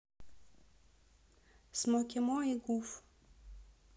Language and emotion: Russian, neutral